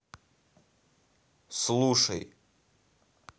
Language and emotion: Russian, angry